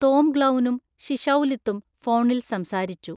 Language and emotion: Malayalam, neutral